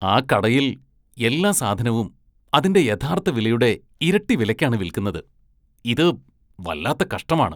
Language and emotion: Malayalam, disgusted